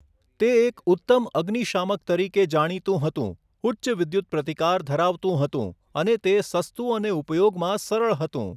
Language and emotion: Gujarati, neutral